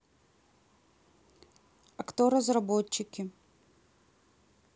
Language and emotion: Russian, neutral